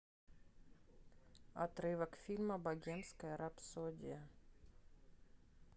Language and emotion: Russian, neutral